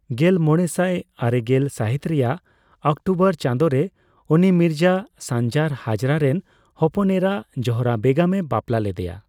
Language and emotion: Santali, neutral